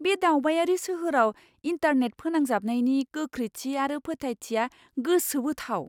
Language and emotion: Bodo, surprised